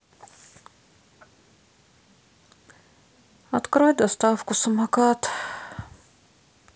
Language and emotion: Russian, sad